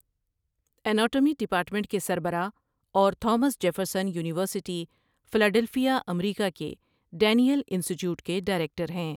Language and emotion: Urdu, neutral